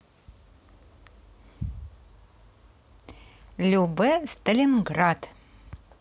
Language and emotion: Russian, positive